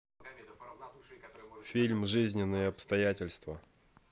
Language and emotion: Russian, neutral